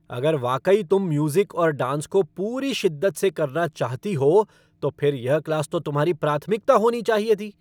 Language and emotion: Hindi, angry